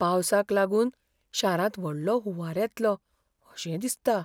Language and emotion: Goan Konkani, fearful